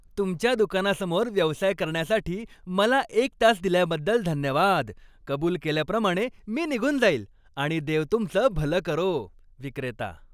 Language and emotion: Marathi, happy